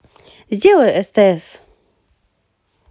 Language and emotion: Russian, positive